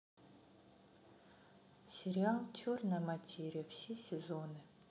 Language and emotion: Russian, sad